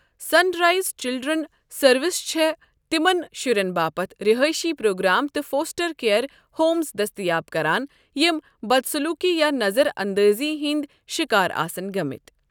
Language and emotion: Kashmiri, neutral